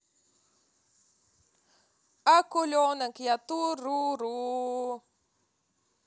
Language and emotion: Russian, positive